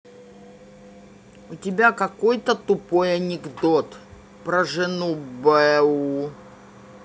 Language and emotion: Russian, angry